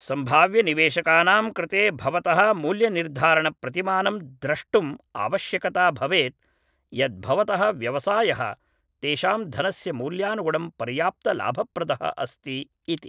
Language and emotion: Sanskrit, neutral